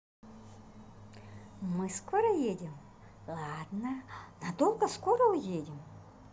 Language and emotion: Russian, positive